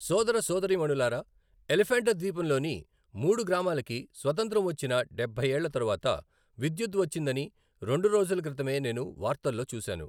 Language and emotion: Telugu, neutral